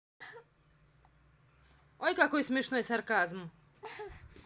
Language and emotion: Russian, angry